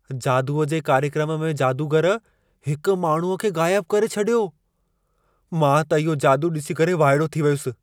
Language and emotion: Sindhi, surprised